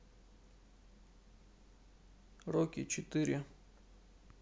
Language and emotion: Russian, neutral